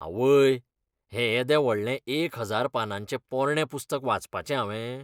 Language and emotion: Goan Konkani, disgusted